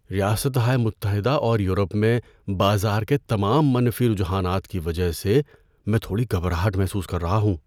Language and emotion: Urdu, fearful